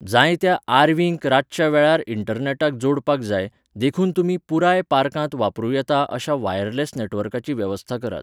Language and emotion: Goan Konkani, neutral